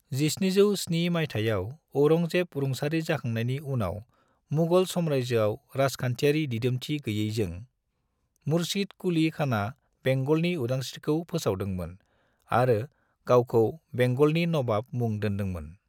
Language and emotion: Bodo, neutral